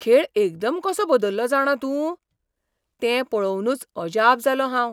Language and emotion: Goan Konkani, surprised